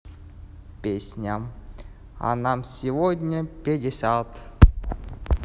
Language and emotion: Russian, positive